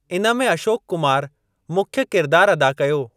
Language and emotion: Sindhi, neutral